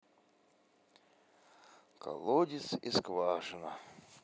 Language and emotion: Russian, sad